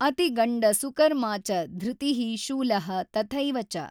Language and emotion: Kannada, neutral